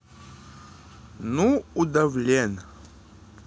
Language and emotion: Russian, positive